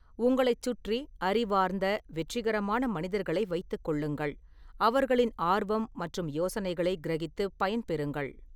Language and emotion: Tamil, neutral